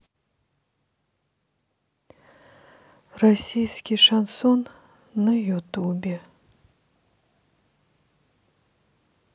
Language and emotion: Russian, sad